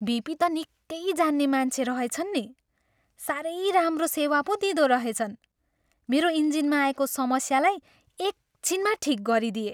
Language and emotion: Nepali, happy